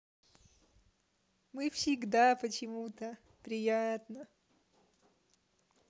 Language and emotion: Russian, positive